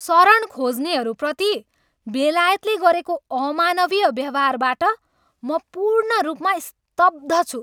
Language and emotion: Nepali, angry